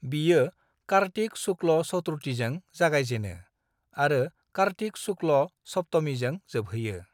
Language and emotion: Bodo, neutral